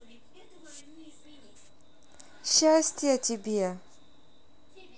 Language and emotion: Russian, positive